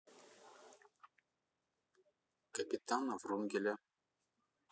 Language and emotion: Russian, neutral